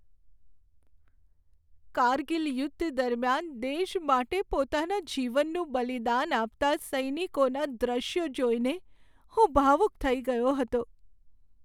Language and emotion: Gujarati, sad